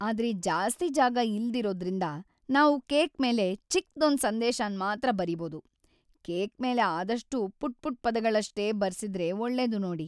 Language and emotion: Kannada, sad